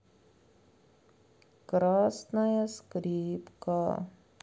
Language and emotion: Russian, sad